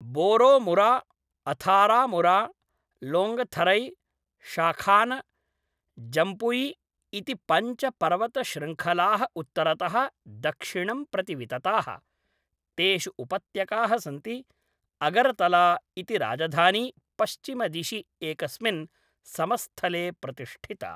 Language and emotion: Sanskrit, neutral